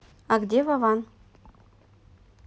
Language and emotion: Russian, neutral